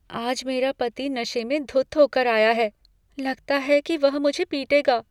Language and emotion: Hindi, fearful